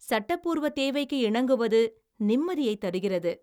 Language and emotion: Tamil, happy